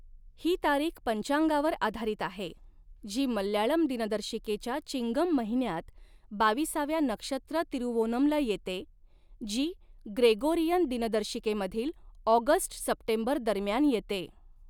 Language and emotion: Marathi, neutral